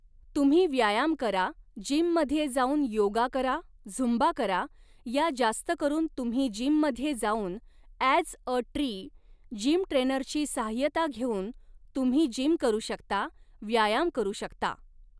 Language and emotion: Marathi, neutral